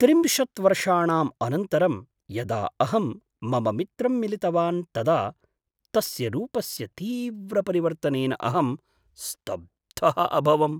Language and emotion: Sanskrit, surprised